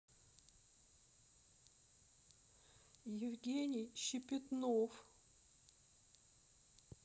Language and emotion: Russian, sad